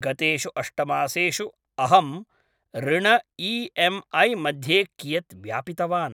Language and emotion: Sanskrit, neutral